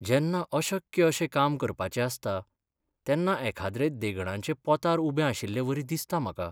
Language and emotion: Goan Konkani, sad